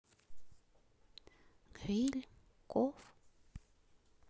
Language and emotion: Russian, neutral